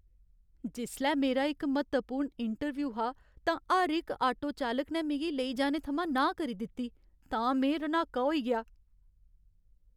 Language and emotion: Dogri, sad